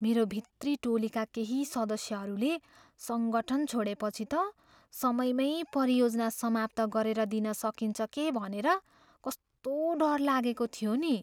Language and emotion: Nepali, fearful